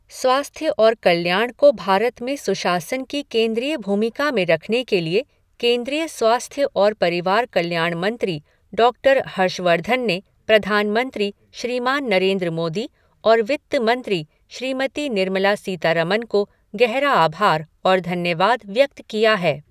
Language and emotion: Hindi, neutral